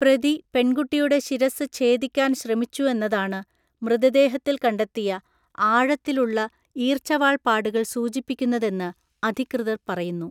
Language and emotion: Malayalam, neutral